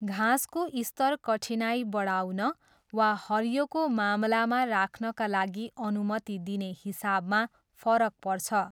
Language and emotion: Nepali, neutral